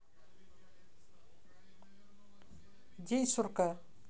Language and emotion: Russian, neutral